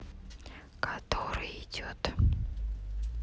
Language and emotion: Russian, neutral